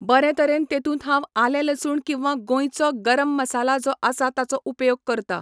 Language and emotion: Goan Konkani, neutral